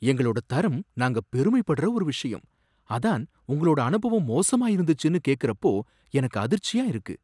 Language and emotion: Tamil, surprised